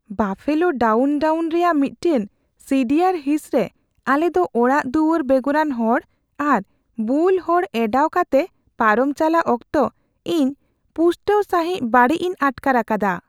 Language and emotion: Santali, fearful